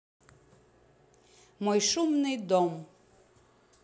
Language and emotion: Russian, neutral